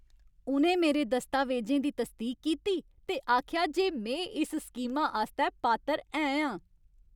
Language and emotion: Dogri, happy